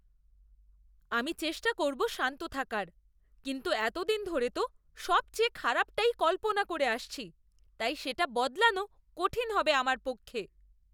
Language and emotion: Bengali, disgusted